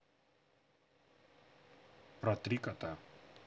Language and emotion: Russian, neutral